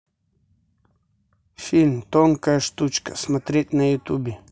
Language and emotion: Russian, neutral